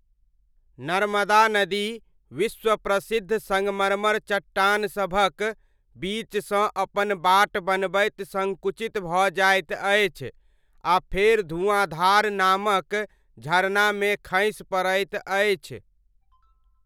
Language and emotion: Maithili, neutral